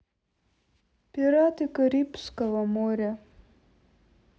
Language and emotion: Russian, sad